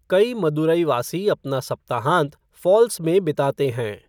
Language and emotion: Hindi, neutral